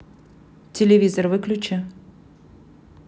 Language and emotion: Russian, neutral